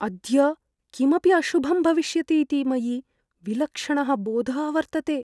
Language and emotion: Sanskrit, fearful